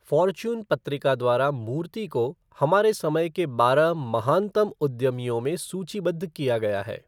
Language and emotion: Hindi, neutral